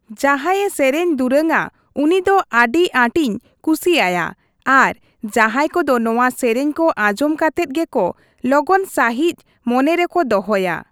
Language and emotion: Santali, neutral